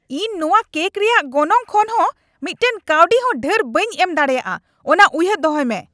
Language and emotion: Santali, angry